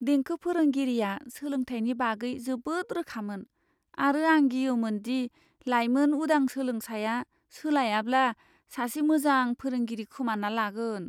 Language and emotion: Bodo, fearful